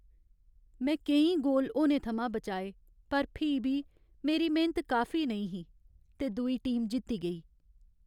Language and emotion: Dogri, sad